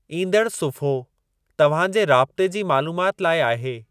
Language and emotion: Sindhi, neutral